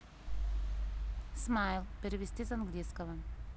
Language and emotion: Russian, neutral